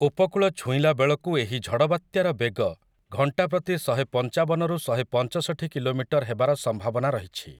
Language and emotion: Odia, neutral